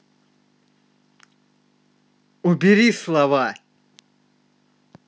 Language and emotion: Russian, angry